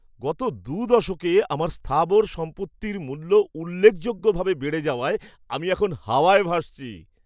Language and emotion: Bengali, happy